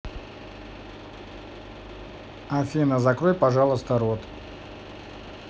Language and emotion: Russian, neutral